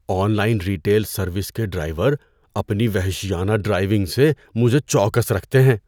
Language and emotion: Urdu, fearful